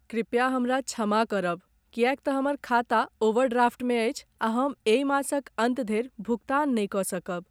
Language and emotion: Maithili, sad